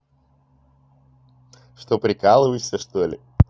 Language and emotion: Russian, positive